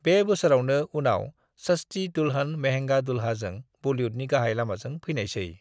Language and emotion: Bodo, neutral